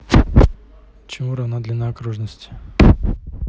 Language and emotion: Russian, neutral